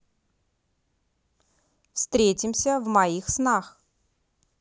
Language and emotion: Russian, neutral